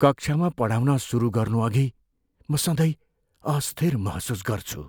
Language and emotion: Nepali, fearful